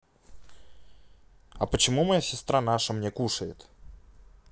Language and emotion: Russian, neutral